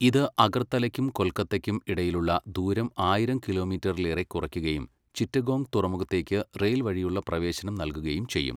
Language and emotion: Malayalam, neutral